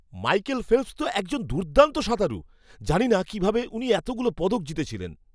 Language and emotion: Bengali, surprised